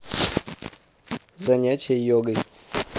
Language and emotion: Russian, neutral